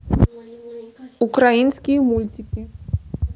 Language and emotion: Russian, neutral